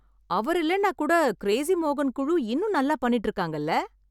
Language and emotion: Tamil, happy